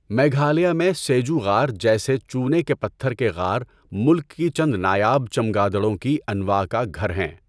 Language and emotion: Urdu, neutral